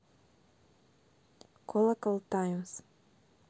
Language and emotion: Russian, neutral